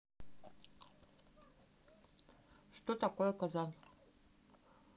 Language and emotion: Russian, neutral